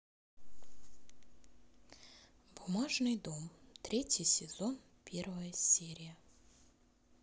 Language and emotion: Russian, neutral